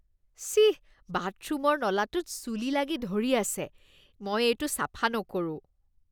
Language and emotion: Assamese, disgusted